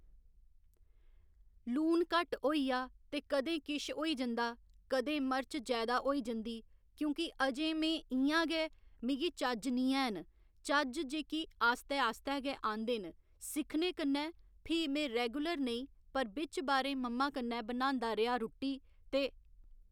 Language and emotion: Dogri, neutral